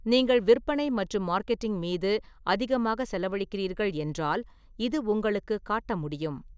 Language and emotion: Tamil, neutral